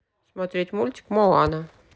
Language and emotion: Russian, neutral